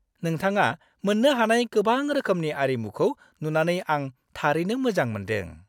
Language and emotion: Bodo, happy